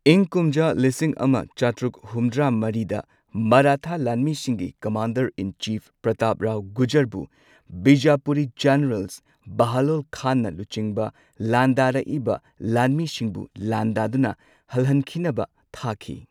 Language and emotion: Manipuri, neutral